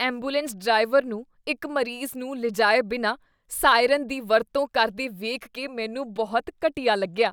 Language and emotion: Punjabi, disgusted